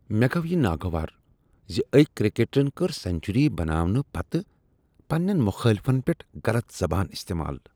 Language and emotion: Kashmiri, disgusted